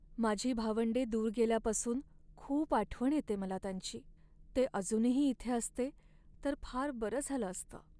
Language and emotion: Marathi, sad